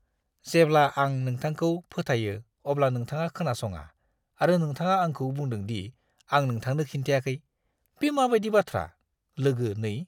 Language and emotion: Bodo, disgusted